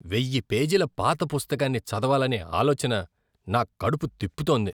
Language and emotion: Telugu, disgusted